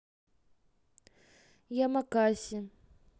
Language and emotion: Russian, neutral